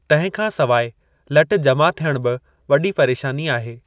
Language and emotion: Sindhi, neutral